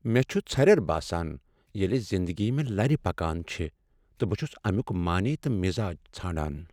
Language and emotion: Kashmiri, sad